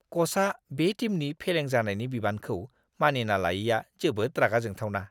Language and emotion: Bodo, disgusted